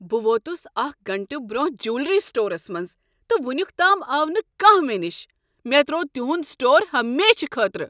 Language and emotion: Kashmiri, angry